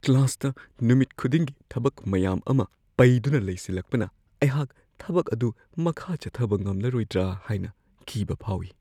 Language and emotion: Manipuri, fearful